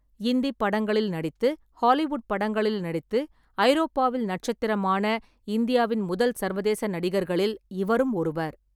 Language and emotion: Tamil, neutral